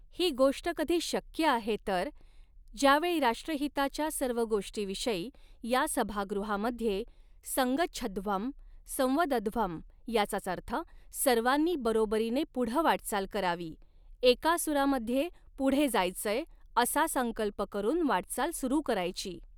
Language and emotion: Marathi, neutral